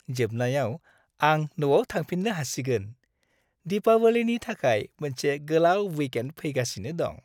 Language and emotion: Bodo, happy